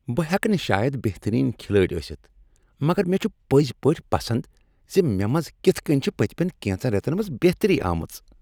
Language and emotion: Kashmiri, happy